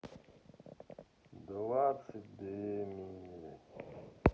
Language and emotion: Russian, sad